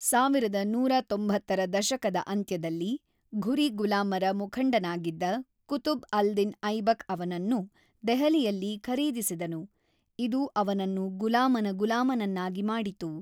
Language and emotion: Kannada, neutral